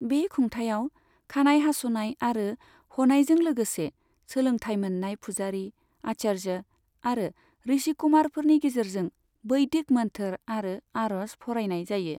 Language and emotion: Bodo, neutral